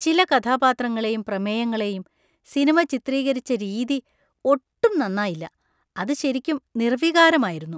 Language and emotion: Malayalam, disgusted